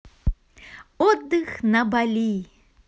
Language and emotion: Russian, positive